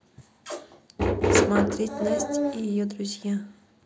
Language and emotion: Russian, neutral